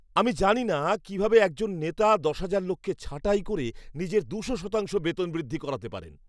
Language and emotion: Bengali, disgusted